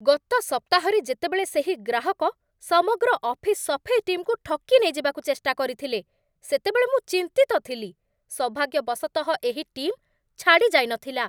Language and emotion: Odia, angry